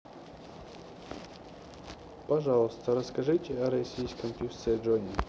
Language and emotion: Russian, neutral